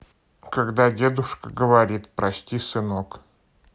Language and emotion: Russian, neutral